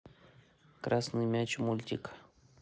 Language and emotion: Russian, neutral